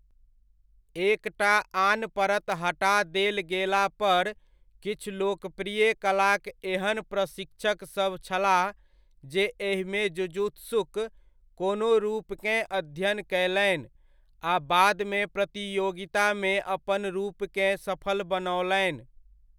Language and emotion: Maithili, neutral